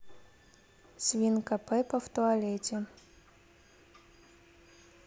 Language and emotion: Russian, neutral